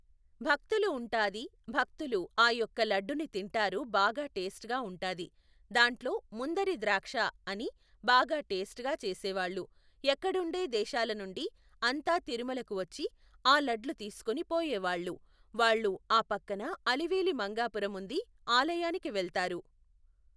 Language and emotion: Telugu, neutral